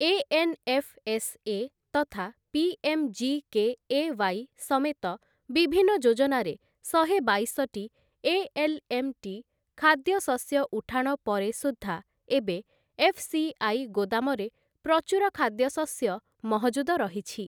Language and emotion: Odia, neutral